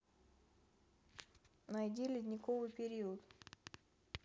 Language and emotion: Russian, neutral